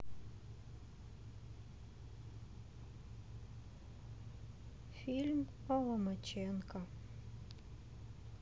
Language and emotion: Russian, sad